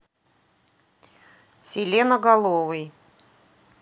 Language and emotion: Russian, neutral